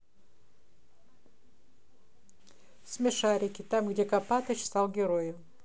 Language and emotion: Russian, neutral